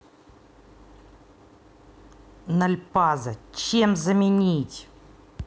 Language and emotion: Russian, angry